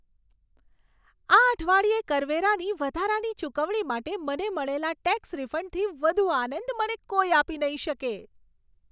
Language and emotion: Gujarati, happy